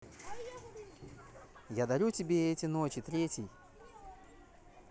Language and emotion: Russian, positive